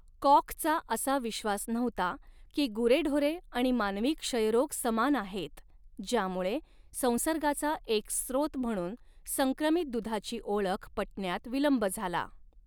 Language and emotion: Marathi, neutral